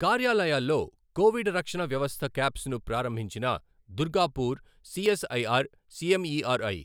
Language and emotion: Telugu, neutral